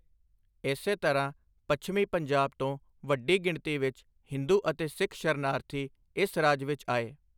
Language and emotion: Punjabi, neutral